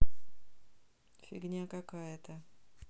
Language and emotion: Russian, neutral